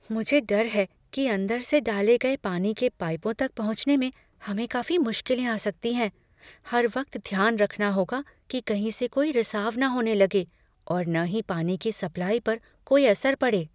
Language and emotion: Hindi, fearful